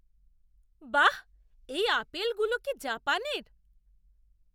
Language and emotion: Bengali, surprised